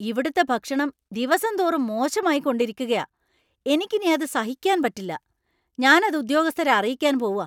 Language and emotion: Malayalam, angry